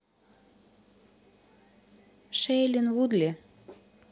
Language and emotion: Russian, neutral